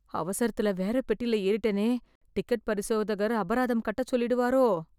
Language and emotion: Tamil, fearful